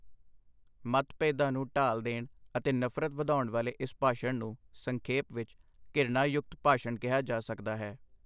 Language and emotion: Punjabi, neutral